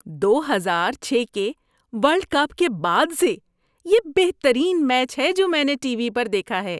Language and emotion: Urdu, happy